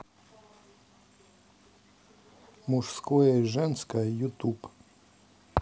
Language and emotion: Russian, neutral